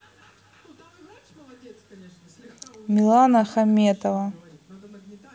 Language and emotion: Russian, neutral